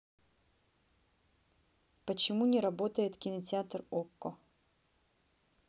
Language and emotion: Russian, neutral